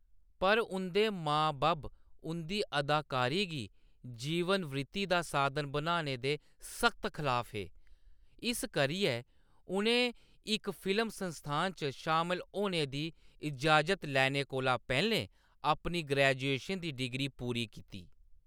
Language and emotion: Dogri, neutral